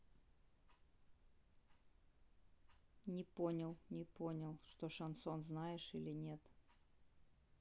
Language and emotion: Russian, neutral